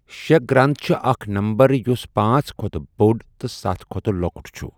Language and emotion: Kashmiri, neutral